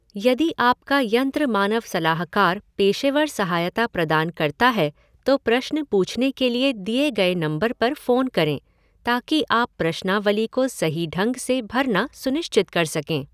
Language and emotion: Hindi, neutral